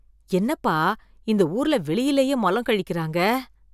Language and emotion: Tamil, disgusted